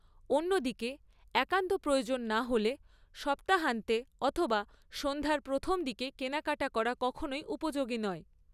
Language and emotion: Bengali, neutral